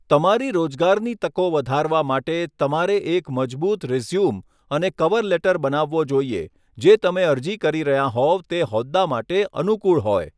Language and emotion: Gujarati, neutral